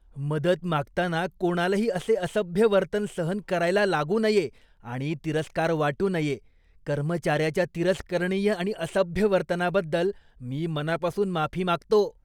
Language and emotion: Marathi, disgusted